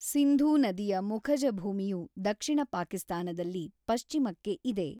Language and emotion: Kannada, neutral